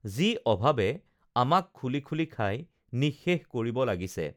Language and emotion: Assamese, neutral